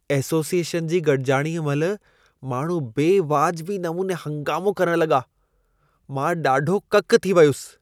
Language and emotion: Sindhi, disgusted